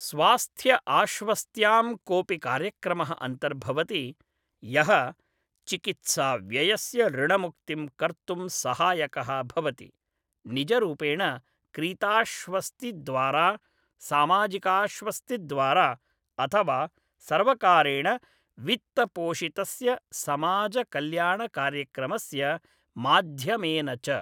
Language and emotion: Sanskrit, neutral